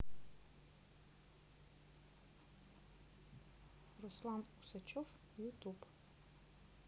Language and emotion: Russian, neutral